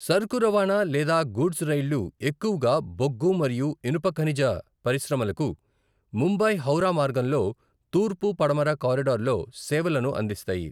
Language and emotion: Telugu, neutral